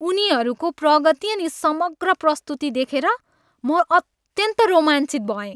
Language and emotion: Nepali, happy